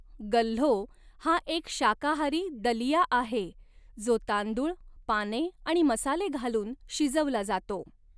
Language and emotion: Marathi, neutral